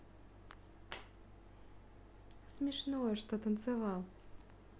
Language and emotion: Russian, positive